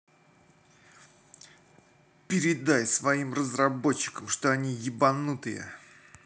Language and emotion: Russian, angry